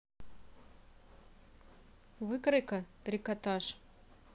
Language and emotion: Russian, neutral